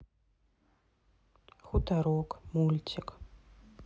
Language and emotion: Russian, sad